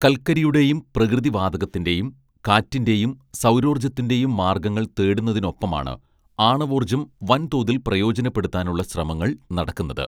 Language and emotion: Malayalam, neutral